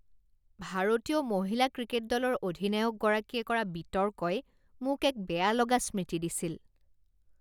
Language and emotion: Assamese, disgusted